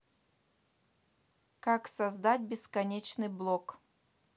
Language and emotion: Russian, neutral